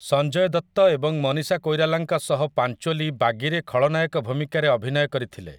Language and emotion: Odia, neutral